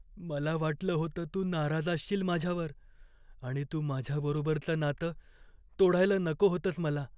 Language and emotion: Marathi, fearful